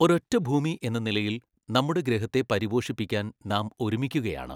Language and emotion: Malayalam, neutral